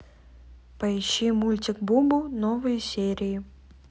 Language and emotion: Russian, neutral